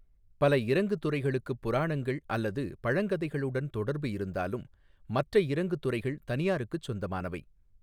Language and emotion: Tamil, neutral